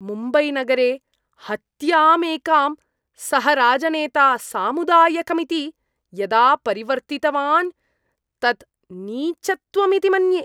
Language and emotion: Sanskrit, disgusted